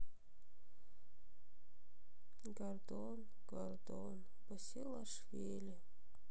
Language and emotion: Russian, sad